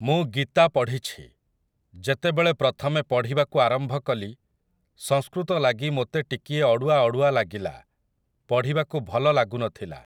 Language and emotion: Odia, neutral